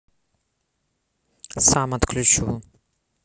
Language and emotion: Russian, neutral